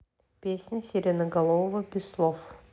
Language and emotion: Russian, neutral